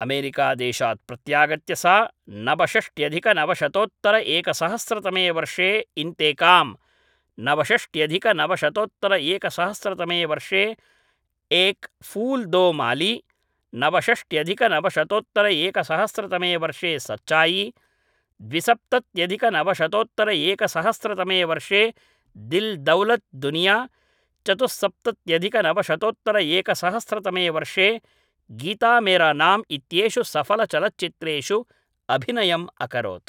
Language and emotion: Sanskrit, neutral